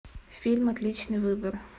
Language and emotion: Russian, neutral